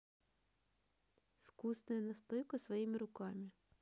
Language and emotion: Russian, neutral